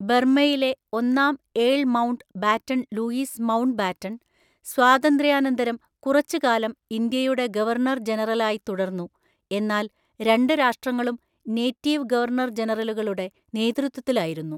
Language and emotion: Malayalam, neutral